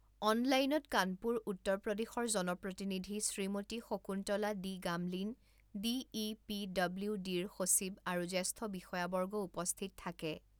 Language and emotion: Assamese, neutral